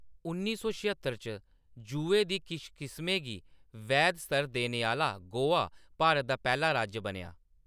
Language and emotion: Dogri, neutral